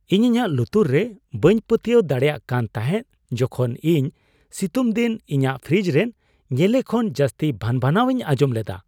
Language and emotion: Santali, surprised